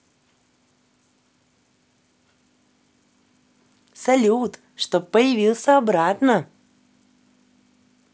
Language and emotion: Russian, positive